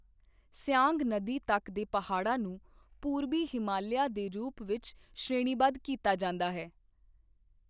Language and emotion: Punjabi, neutral